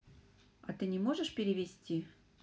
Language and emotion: Russian, neutral